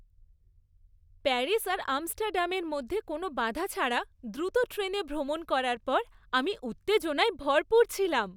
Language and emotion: Bengali, happy